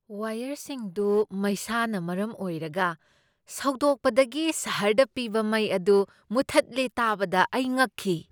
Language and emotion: Manipuri, surprised